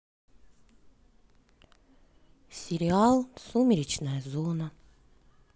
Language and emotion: Russian, sad